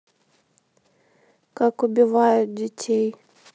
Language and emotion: Russian, neutral